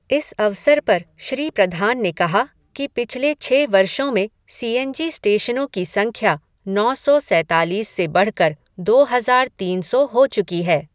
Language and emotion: Hindi, neutral